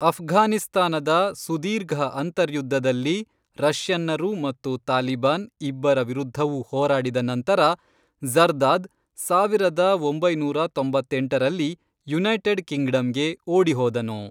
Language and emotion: Kannada, neutral